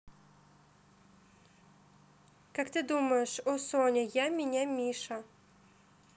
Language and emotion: Russian, neutral